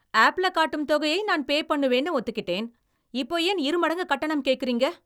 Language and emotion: Tamil, angry